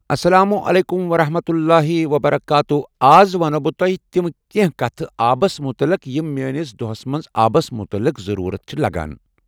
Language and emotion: Kashmiri, neutral